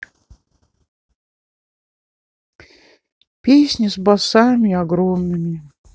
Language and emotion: Russian, sad